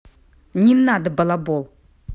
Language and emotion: Russian, angry